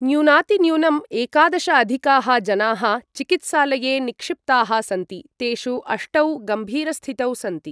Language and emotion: Sanskrit, neutral